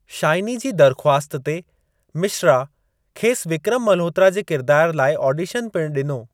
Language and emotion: Sindhi, neutral